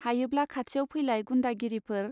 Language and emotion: Bodo, neutral